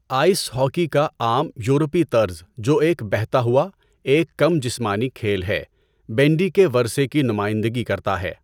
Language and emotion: Urdu, neutral